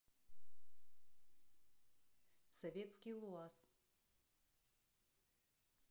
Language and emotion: Russian, neutral